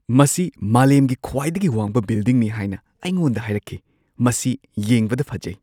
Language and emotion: Manipuri, surprised